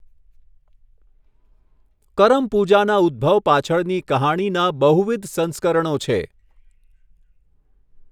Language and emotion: Gujarati, neutral